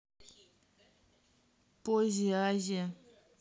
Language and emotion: Russian, neutral